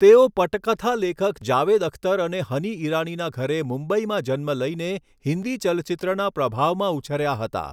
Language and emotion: Gujarati, neutral